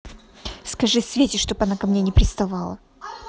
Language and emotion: Russian, angry